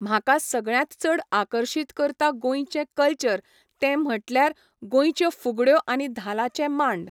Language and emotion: Goan Konkani, neutral